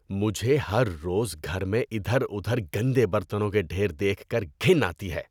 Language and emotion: Urdu, disgusted